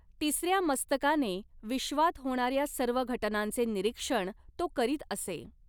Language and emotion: Marathi, neutral